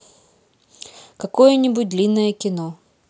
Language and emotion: Russian, neutral